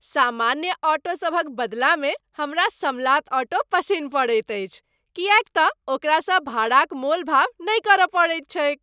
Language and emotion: Maithili, happy